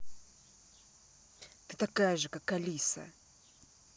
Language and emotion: Russian, angry